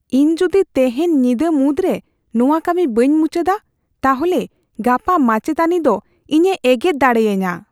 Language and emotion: Santali, fearful